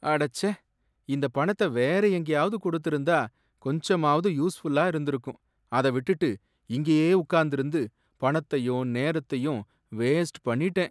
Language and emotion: Tamil, sad